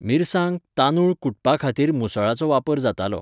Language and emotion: Goan Konkani, neutral